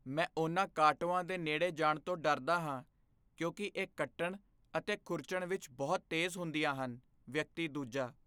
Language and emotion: Punjabi, fearful